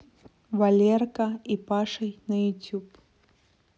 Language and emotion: Russian, neutral